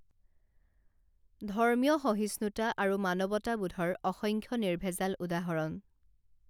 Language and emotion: Assamese, neutral